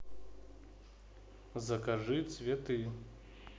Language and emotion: Russian, neutral